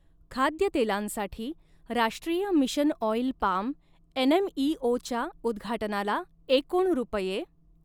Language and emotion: Marathi, neutral